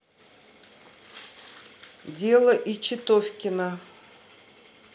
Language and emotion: Russian, neutral